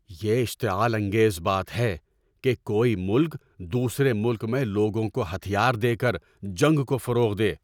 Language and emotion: Urdu, angry